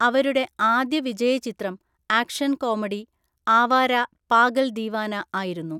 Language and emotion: Malayalam, neutral